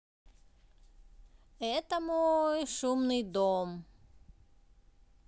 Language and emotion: Russian, neutral